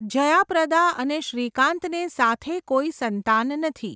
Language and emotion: Gujarati, neutral